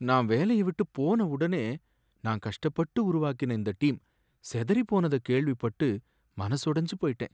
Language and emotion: Tamil, sad